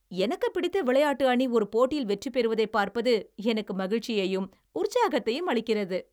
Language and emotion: Tamil, happy